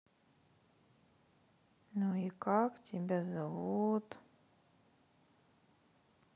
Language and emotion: Russian, sad